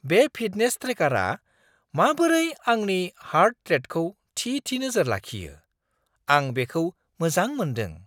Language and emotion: Bodo, surprised